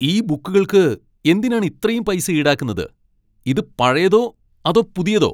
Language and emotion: Malayalam, angry